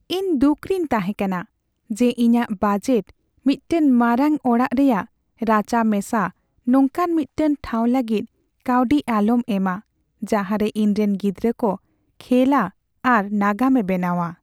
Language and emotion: Santali, sad